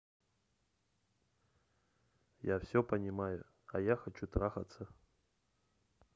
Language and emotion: Russian, neutral